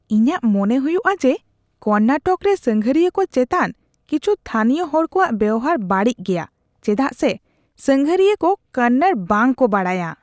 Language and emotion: Santali, disgusted